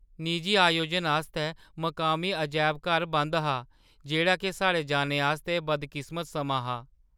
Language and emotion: Dogri, sad